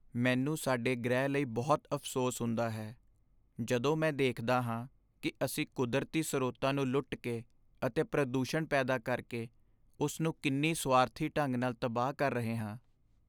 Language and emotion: Punjabi, sad